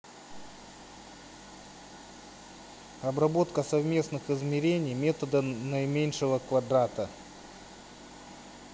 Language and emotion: Russian, neutral